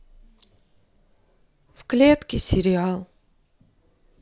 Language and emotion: Russian, sad